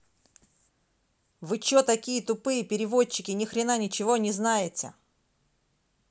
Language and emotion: Russian, angry